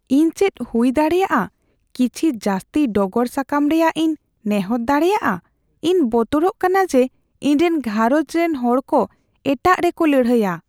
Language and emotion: Santali, fearful